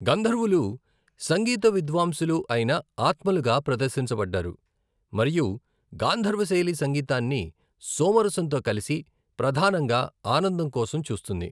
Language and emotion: Telugu, neutral